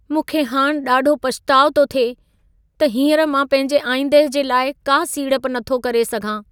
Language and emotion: Sindhi, sad